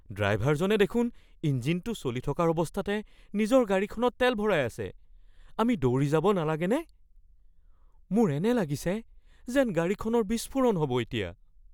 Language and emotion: Assamese, fearful